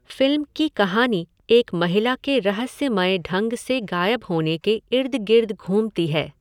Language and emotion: Hindi, neutral